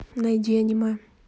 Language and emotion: Russian, neutral